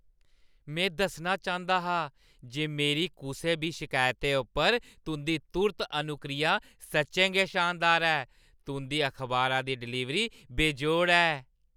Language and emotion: Dogri, happy